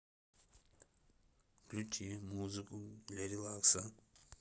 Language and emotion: Russian, neutral